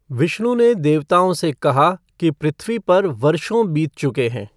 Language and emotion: Hindi, neutral